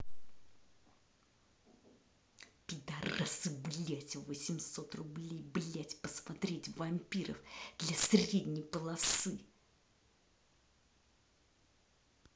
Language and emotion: Russian, angry